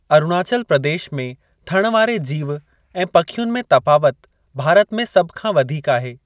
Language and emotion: Sindhi, neutral